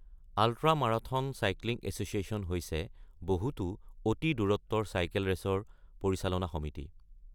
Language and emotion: Assamese, neutral